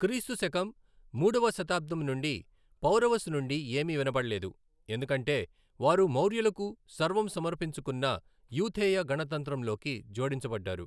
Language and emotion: Telugu, neutral